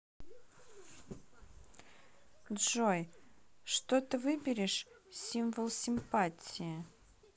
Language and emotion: Russian, neutral